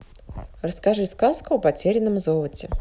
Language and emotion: Russian, neutral